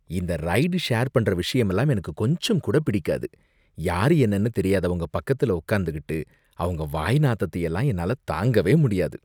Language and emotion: Tamil, disgusted